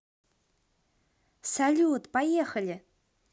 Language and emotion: Russian, positive